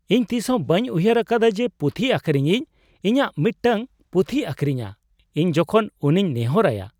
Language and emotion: Santali, surprised